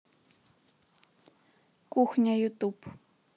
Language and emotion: Russian, neutral